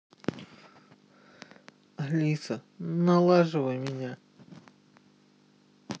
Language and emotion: Russian, sad